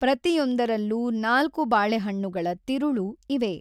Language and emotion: Kannada, neutral